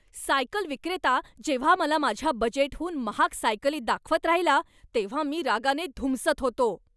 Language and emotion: Marathi, angry